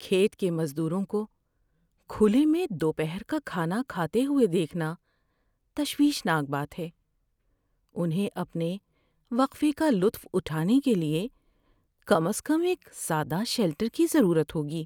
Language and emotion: Urdu, sad